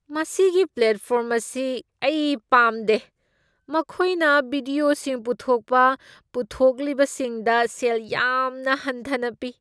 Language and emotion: Manipuri, disgusted